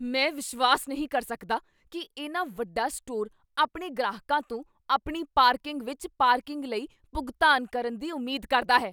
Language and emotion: Punjabi, angry